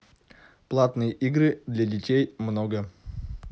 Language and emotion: Russian, neutral